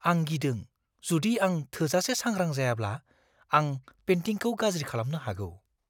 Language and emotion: Bodo, fearful